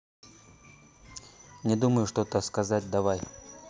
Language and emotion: Russian, neutral